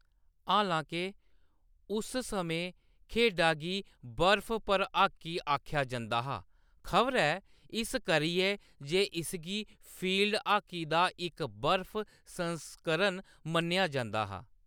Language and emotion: Dogri, neutral